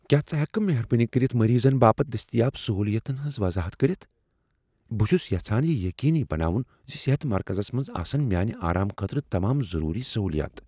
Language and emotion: Kashmiri, fearful